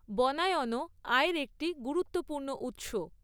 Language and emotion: Bengali, neutral